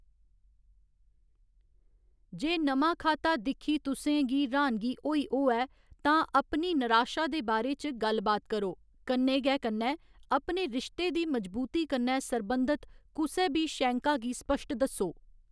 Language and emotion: Dogri, neutral